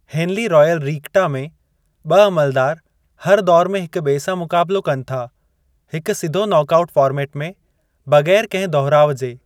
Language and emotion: Sindhi, neutral